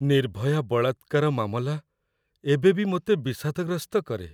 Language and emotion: Odia, sad